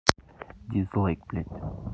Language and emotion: Russian, angry